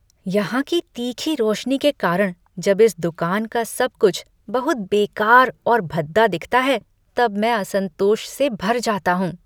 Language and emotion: Hindi, disgusted